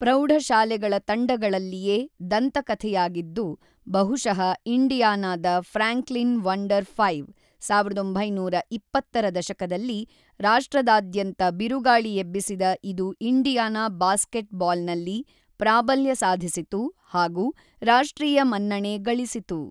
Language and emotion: Kannada, neutral